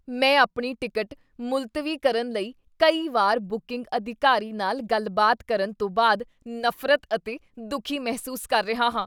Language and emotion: Punjabi, disgusted